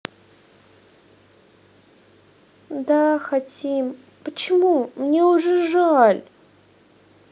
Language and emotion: Russian, sad